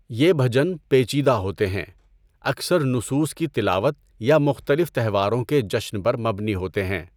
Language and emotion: Urdu, neutral